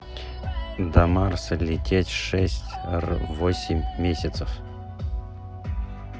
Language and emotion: Russian, neutral